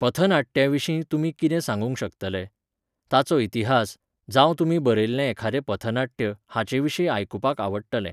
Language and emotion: Goan Konkani, neutral